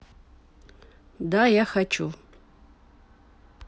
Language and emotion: Russian, neutral